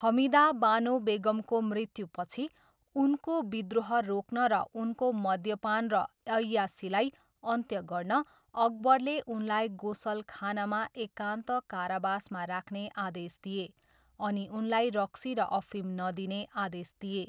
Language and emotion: Nepali, neutral